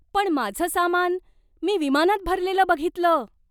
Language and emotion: Marathi, surprised